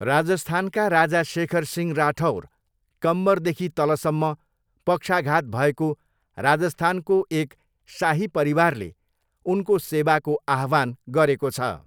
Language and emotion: Nepali, neutral